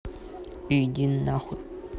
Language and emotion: Russian, angry